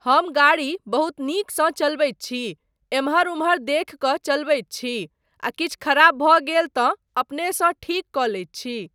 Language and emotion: Maithili, neutral